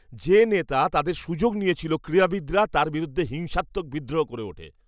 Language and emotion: Bengali, angry